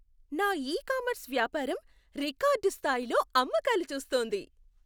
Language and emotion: Telugu, happy